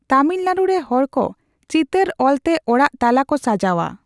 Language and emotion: Santali, neutral